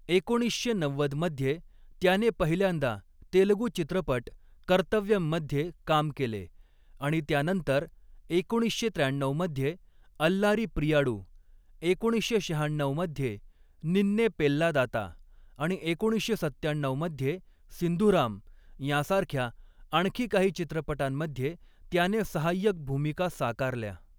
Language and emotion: Marathi, neutral